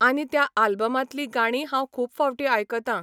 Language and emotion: Goan Konkani, neutral